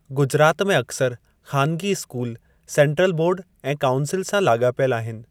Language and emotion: Sindhi, neutral